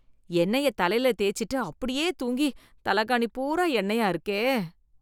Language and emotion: Tamil, disgusted